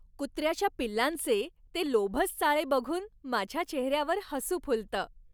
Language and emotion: Marathi, happy